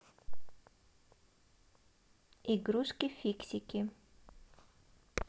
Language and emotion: Russian, positive